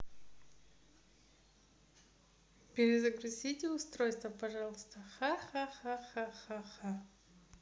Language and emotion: Russian, positive